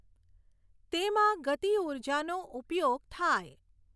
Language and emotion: Gujarati, neutral